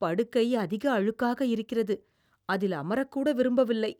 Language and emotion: Tamil, disgusted